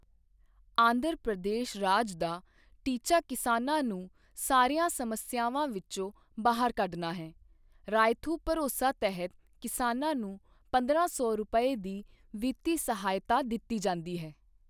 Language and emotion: Punjabi, neutral